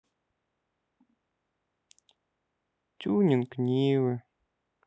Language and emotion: Russian, sad